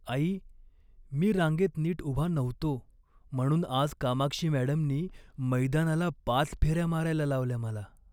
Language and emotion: Marathi, sad